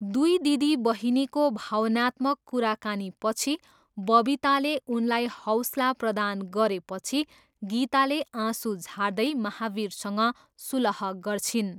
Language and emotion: Nepali, neutral